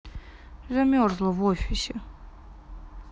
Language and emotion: Russian, sad